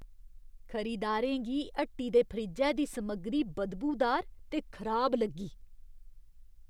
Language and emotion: Dogri, disgusted